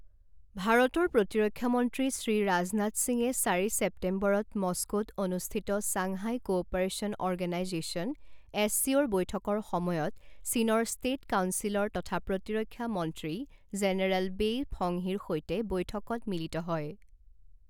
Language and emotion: Assamese, neutral